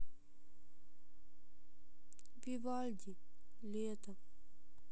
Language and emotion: Russian, sad